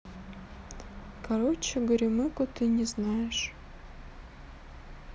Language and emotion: Russian, sad